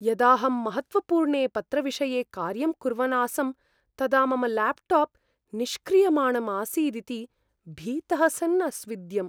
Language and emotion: Sanskrit, fearful